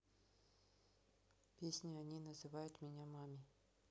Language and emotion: Russian, neutral